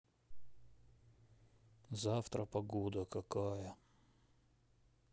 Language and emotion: Russian, sad